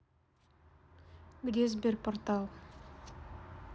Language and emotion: Russian, neutral